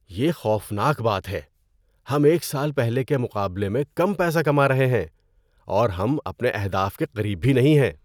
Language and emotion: Urdu, disgusted